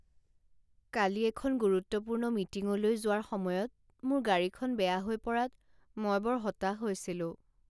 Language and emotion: Assamese, sad